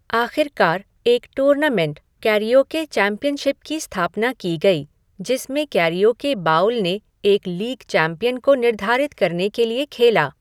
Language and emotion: Hindi, neutral